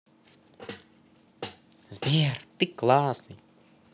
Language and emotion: Russian, positive